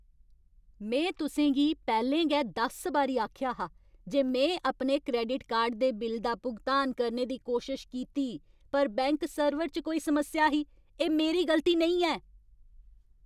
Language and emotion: Dogri, angry